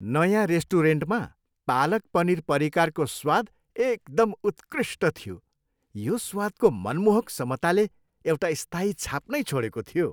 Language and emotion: Nepali, happy